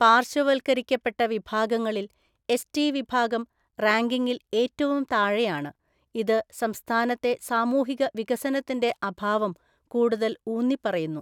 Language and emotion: Malayalam, neutral